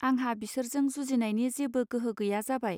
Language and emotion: Bodo, neutral